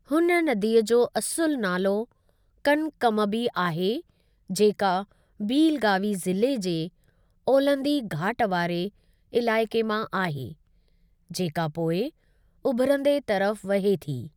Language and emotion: Sindhi, neutral